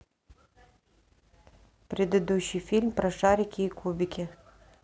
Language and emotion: Russian, neutral